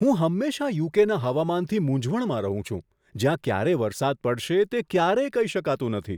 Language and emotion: Gujarati, surprised